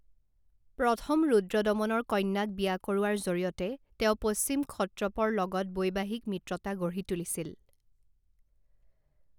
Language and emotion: Assamese, neutral